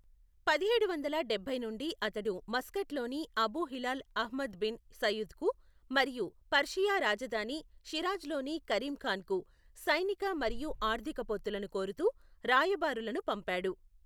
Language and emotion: Telugu, neutral